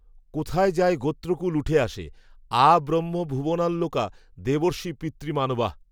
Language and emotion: Bengali, neutral